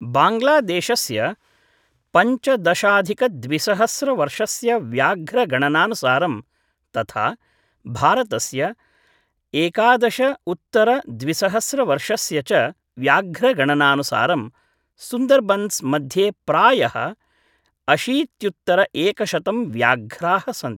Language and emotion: Sanskrit, neutral